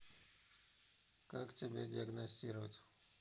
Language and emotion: Russian, neutral